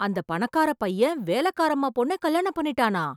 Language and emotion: Tamil, surprised